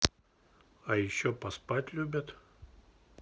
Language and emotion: Russian, neutral